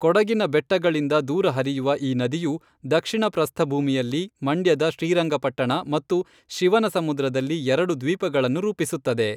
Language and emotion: Kannada, neutral